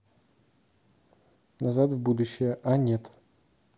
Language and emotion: Russian, neutral